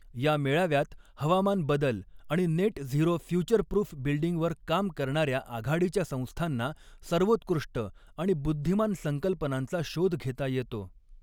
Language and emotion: Marathi, neutral